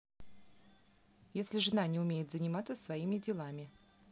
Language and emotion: Russian, neutral